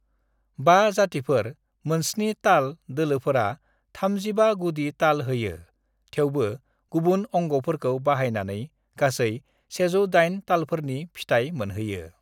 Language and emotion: Bodo, neutral